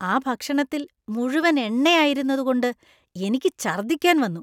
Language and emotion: Malayalam, disgusted